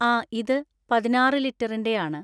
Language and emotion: Malayalam, neutral